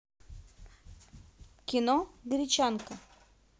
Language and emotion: Russian, neutral